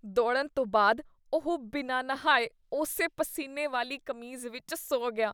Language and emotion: Punjabi, disgusted